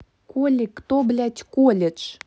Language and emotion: Russian, angry